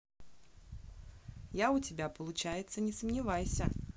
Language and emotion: Russian, positive